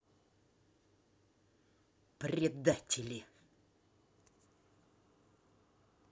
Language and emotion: Russian, angry